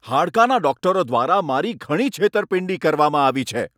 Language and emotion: Gujarati, angry